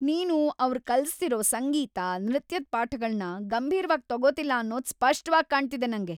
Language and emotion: Kannada, angry